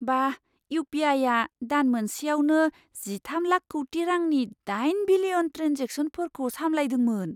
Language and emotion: Bodo, surprised